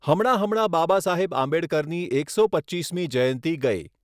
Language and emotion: Gujarati, neutral